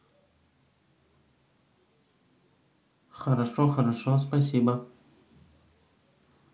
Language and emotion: Russian, neutral